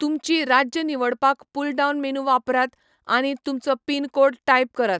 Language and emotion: Goan Konkani, neutral